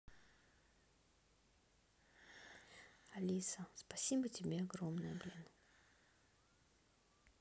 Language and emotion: Russian, neutral